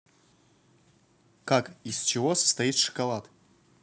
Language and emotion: Russian, neutral